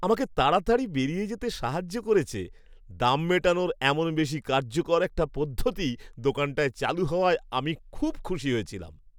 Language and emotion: Bengali, happy